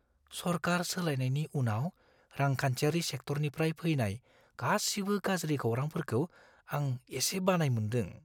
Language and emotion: Bodo, fearful